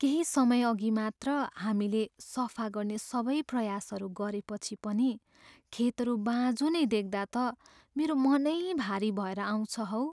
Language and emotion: Nepali, sad